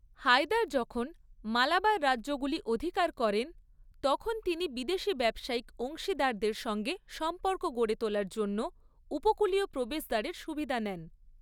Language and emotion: Bengali, neutral